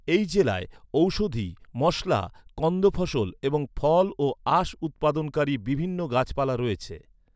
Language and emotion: Bengali, neutral